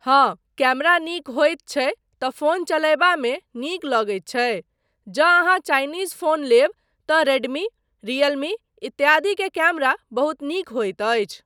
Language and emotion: Maithili, neutral